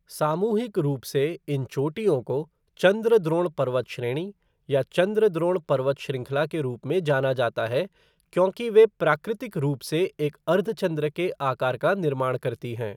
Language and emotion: Hindi, neutral